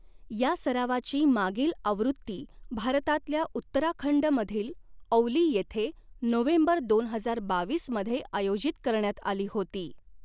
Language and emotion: Marathi, neutral